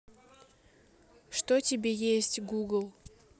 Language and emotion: Russian, neutral